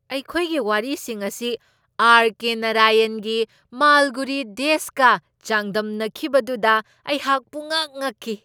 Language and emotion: Manipuri, surprised